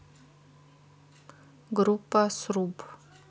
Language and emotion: Russian, neutral